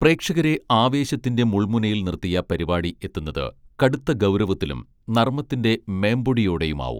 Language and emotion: Malayalam, neutral